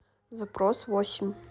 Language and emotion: Russian, neutral